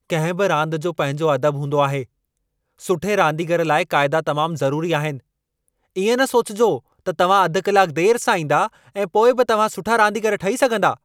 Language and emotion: Sindhi, angry